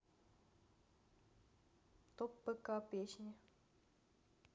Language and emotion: Russian, neutral